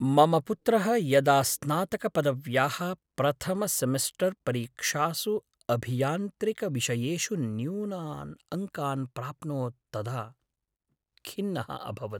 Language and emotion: Sanskrit, sad